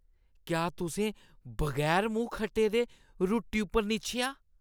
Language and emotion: Dogri, disgusted